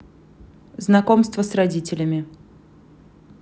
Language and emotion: Russian, neutral